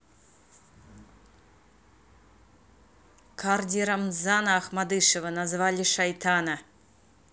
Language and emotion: Russian, angry